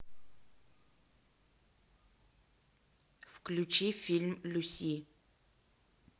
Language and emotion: Russian, neutral